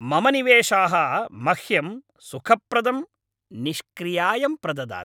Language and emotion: Sanskrit, happy